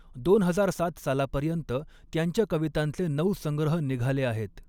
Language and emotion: Marathi, neutral